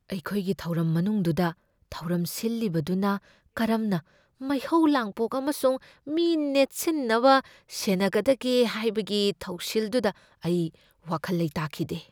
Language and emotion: Manipuri, fearful